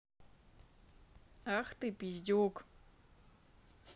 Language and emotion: Russian, angry